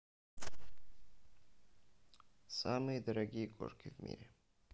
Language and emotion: Russian, neutral